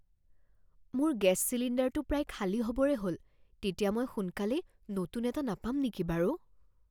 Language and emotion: Assamese, fearful